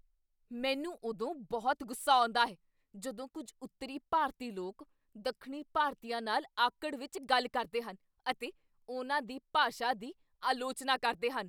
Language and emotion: Punjabi, angry